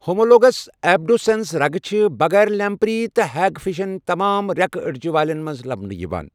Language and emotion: Kashmiri, neutral